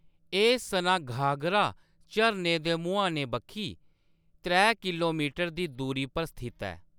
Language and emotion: Dogri, neutral